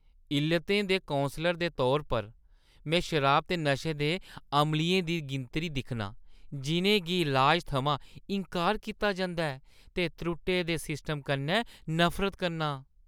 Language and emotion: Dogri, disgusted